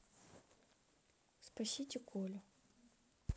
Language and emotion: Russian, neutral